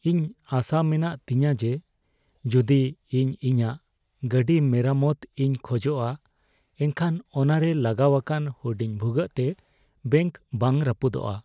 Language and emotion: Santali, fearful